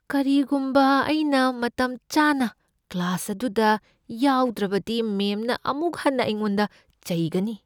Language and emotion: Manipuri, fearful